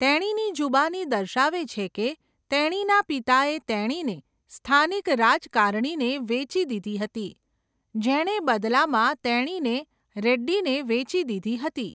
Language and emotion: Gujarati, neutral